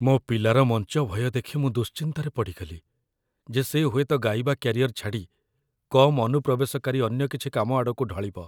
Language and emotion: Odia, fearful